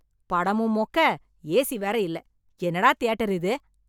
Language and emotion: Tamil, angry